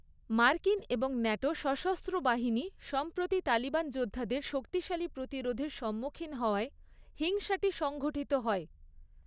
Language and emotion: Bengali, neutral